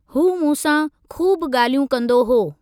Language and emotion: Sindhi, neutral